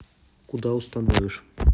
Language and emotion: Russian, neutral